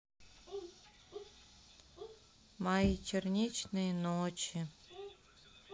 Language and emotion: Russian, sad